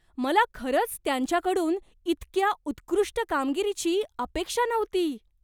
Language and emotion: Marathi, surprised